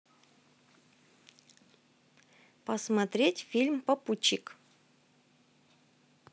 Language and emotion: Russian, neutral